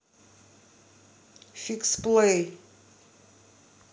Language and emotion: Russian, angry